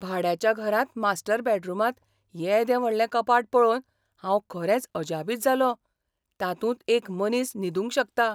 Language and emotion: Goan Konkani, surprised